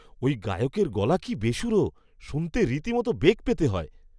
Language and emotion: Bengali, disgusted